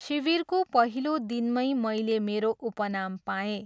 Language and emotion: Nepali, neutral